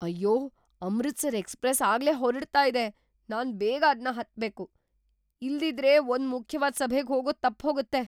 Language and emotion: Kannada, surprised